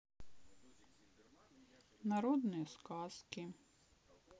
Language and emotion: Russian, sad